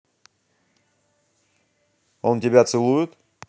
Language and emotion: Russian, angry